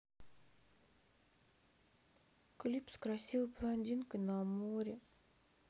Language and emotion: Russian, sad